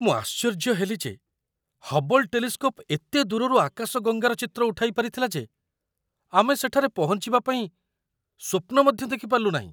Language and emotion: Odia, surprised